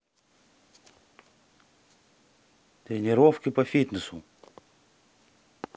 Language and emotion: Russian, neutral